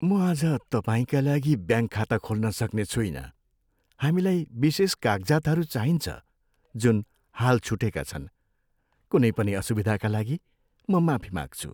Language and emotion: Nepali, sad